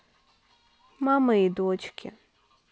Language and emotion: Russian, sad